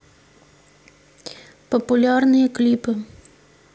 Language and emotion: Russian, neutral